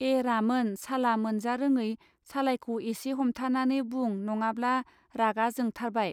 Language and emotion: Bodo, neutral